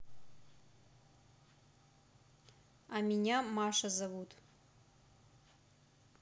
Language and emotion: Russian, neutral